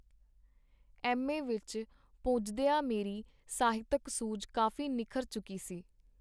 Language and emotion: Punjabi, neutral